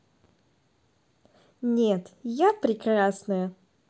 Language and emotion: Russian, positive